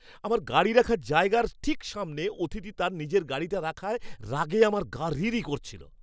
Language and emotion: Bengali, angry